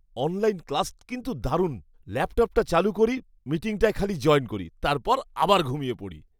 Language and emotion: Bengali, happy